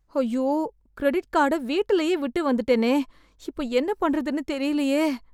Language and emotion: Tamil, fearful